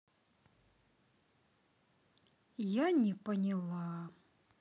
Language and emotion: Russian, sad